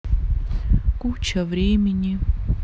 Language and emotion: Russian, neutral